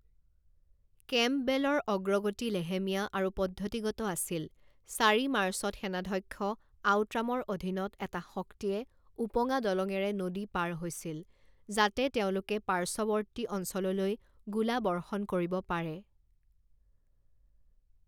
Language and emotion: Assamese, neutral